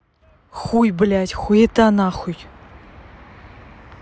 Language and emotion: Russian, angry